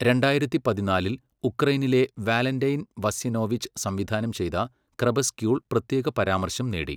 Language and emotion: Malayalam, neutral